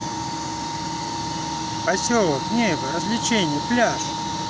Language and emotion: Russian, neutral